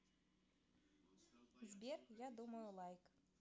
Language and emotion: Russian, positive